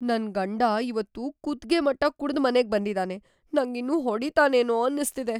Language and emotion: Kannada, fearful